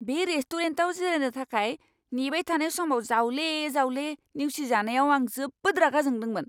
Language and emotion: Bodo, angry